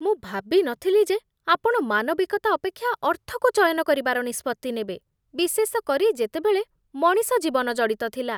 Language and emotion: Odia, disgusted